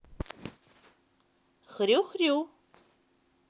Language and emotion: Russian, positive